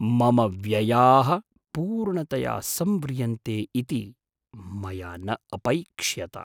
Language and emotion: Sanskrit, surprised